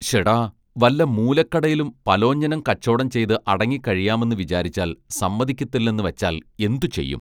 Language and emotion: Malayalam, neutral